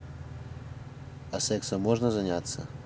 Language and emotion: Russian, neutral